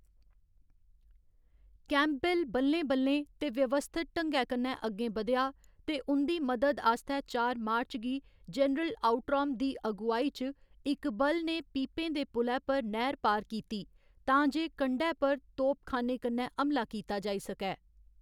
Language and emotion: Dogri, neutral